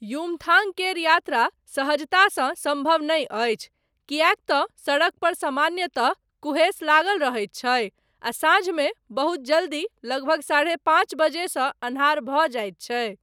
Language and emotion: Maithili, neutral